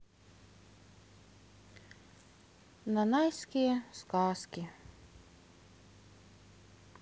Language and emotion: Russian, sad